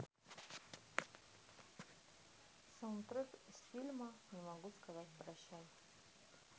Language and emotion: Russian, neutral